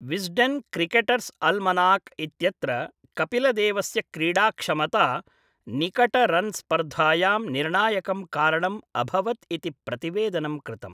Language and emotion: Sanskrit, neutral